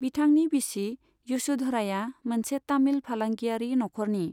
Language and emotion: Bodo, neutral